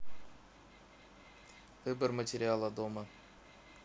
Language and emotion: Russian, neutral